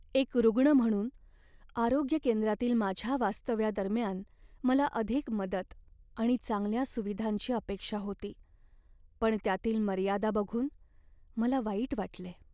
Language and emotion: Marathi, sad